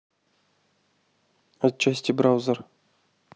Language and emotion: Russian, neutral